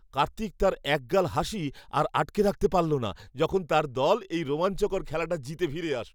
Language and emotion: Bengali, happy